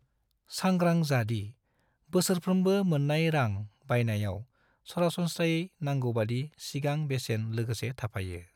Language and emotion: Bodo, neutral